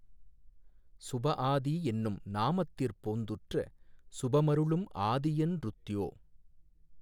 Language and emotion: Tamil, neutral